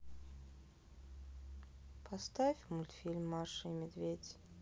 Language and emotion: Russian, sad